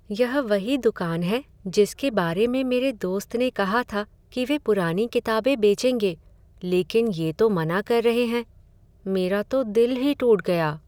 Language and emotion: Hindi, sad